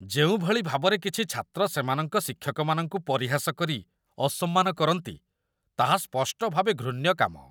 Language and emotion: Odia, disgusted